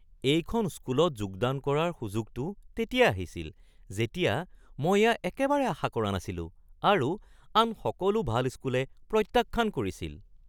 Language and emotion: Assamese, surprised